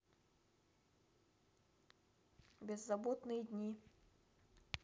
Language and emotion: Russian, neutral